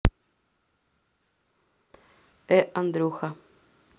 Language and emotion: Russian, neutral